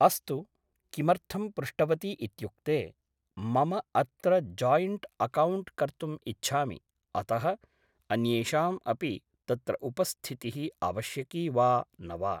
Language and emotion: Sanskrit, neutral